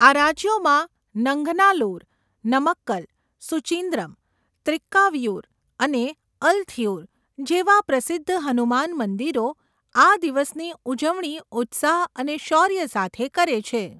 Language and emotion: Gujarati, neutral